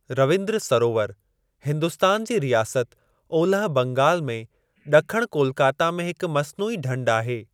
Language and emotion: Sindhi, neutral